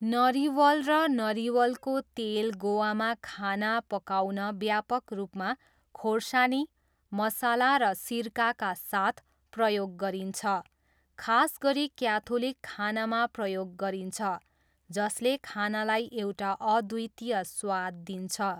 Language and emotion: Nepali, neutral